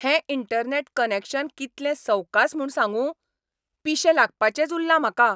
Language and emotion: Goan Konkani, angry